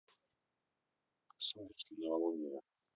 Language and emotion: Russian, neutral